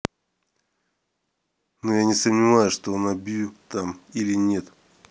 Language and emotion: Russian, neutral